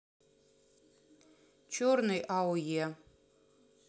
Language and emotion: Russian, neutral